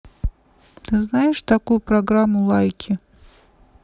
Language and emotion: Russian, neutral